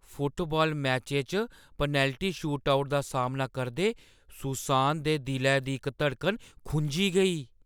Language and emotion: Dogri, fearful